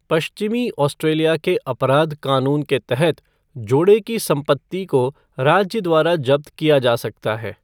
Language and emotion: Hindi, neutral